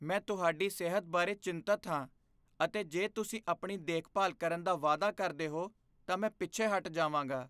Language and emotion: Punjabi, fearful